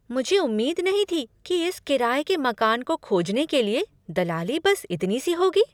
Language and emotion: Hindi, surprised